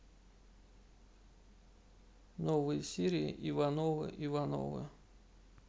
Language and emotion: Russian, neutral